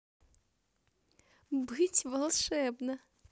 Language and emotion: Russian, positive